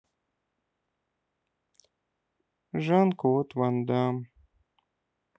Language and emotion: Russian, sad